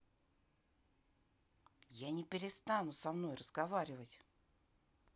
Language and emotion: Russian, neutral